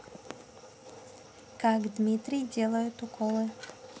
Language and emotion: Russian, neutral